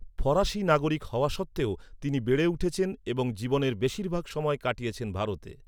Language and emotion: Bengali, neutral